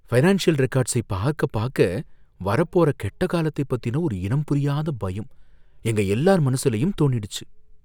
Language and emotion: Tamil, fearful